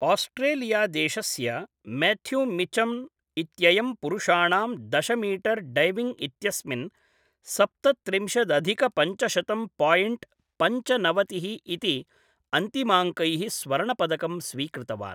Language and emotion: Sanskrit, neutral